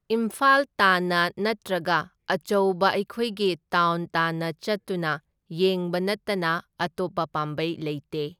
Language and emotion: Manipuri, neutral